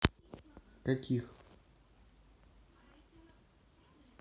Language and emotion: Russian, neutral